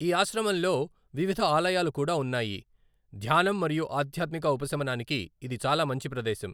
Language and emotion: Telugu, neutral